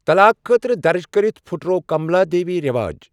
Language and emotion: Kashmiri, neutral